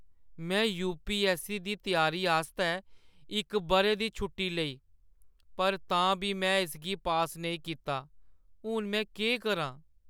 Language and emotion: Dogri, sad